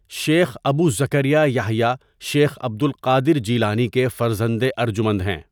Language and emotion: Urdu, neutral